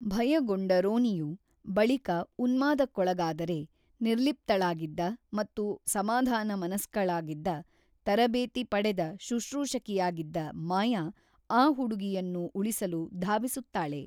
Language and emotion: Kannada, neutral